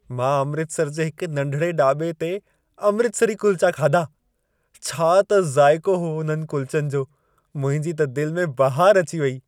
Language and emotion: Sindhi, happy